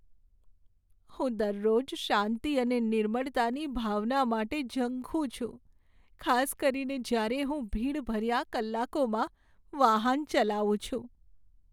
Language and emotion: Gujarati, sad